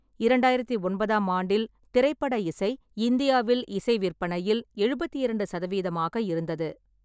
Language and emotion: Tamil, neutral